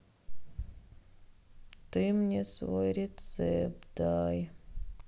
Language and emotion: Russian, sad